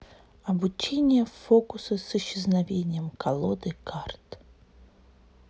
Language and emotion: Russian, neutral